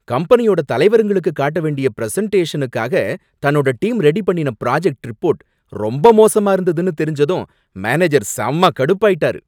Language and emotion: Tamil, angry